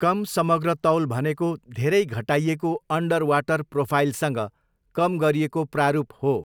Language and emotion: Nepali, neutral